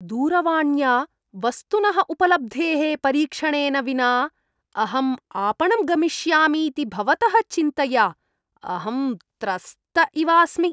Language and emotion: Sanskrit, disgusted